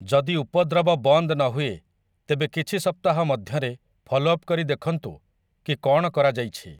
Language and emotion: Odia, neutral